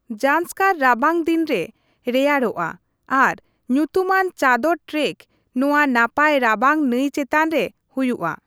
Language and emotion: Santali, neutral